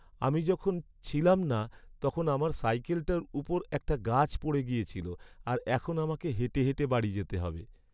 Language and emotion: Bengali, sad